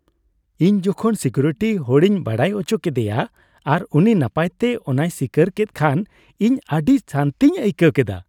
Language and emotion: Santali, happy